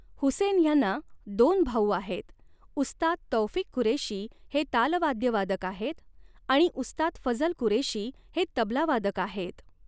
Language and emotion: Marathi, neutral